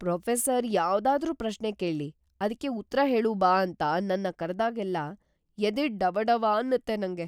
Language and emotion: Kannada, fearful